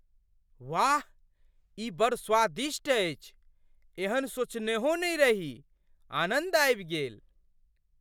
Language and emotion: Maithili, surprised